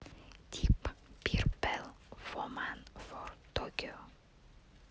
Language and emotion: Russian, neutral